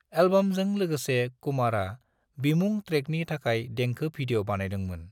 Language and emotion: Bodo, neutral